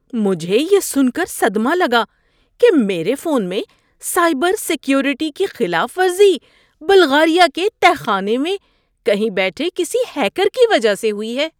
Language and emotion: Urdu, surprised